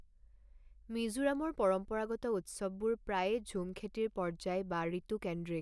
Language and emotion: Assamese, neutral